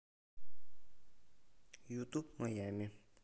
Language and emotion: Russian, neutral